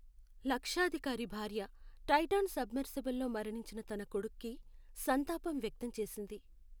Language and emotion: Telugu, sad